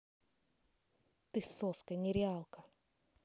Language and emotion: Russian, angry